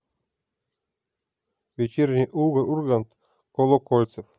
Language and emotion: Russian, neutral